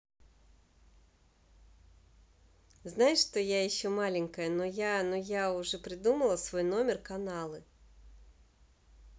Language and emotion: Russian, positive